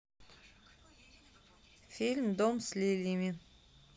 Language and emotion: Russian, neutral